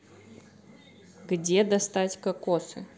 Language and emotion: Russian, neutral